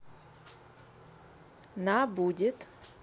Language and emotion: Russian, neutral